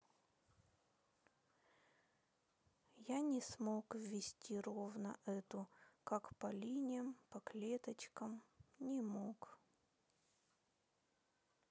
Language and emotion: Russian, sad